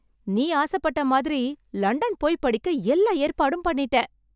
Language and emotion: Tamil, happy